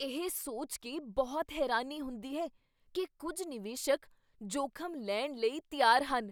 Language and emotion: Punjabi, surprised